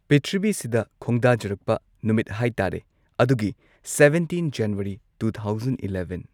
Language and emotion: Manipuri, neutral